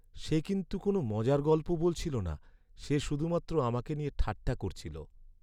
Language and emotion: Bengali, sad